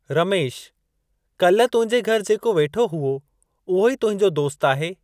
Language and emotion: Sindhi, neutral